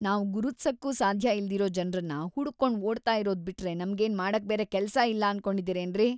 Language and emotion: Kannada, disgusted